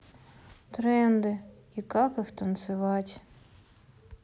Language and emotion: Russian, sad